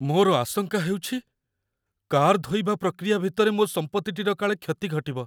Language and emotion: Odia, fearful